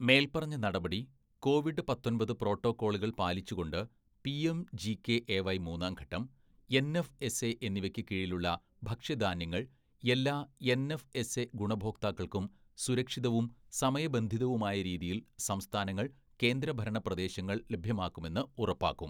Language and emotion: Malayalam, neutral